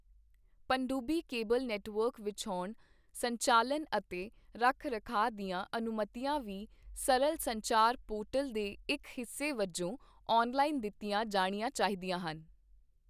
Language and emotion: Punjabi, neutral